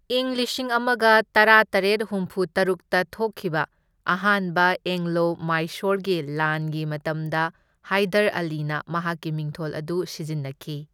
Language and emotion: Manipuri, neutral